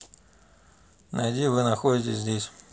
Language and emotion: Russian, neutral